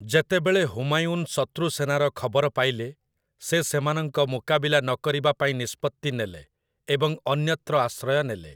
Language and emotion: Odia, neutral